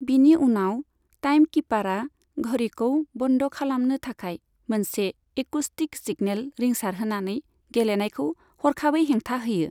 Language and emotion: Bodo, neutral